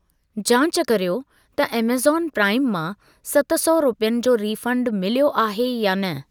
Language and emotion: Sindhi, neutral